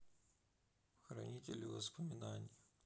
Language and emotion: Russian, sad